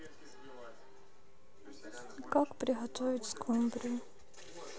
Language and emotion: Russian, sad